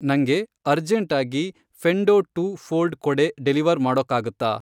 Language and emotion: Kannada, neutral